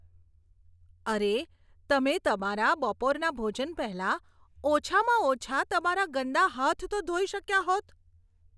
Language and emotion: Gujarati, disgusted